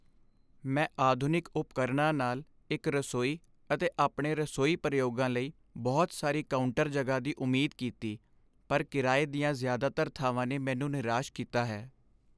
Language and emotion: Punjabi, sad